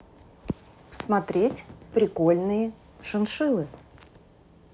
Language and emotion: Russian, neutral